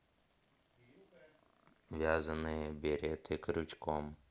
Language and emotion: Russian, neutral